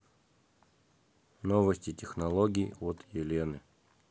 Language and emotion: Russian, neutral